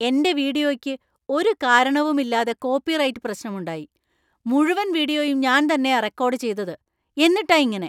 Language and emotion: Malayalam, angry